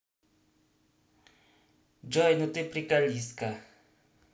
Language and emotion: Russian, positive